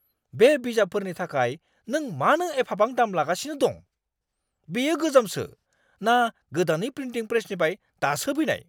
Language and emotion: Bodo, angry